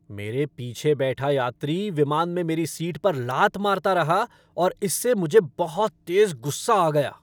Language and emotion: Hindi, angry